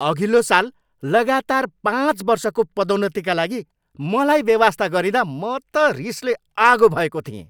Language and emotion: Nepali, angry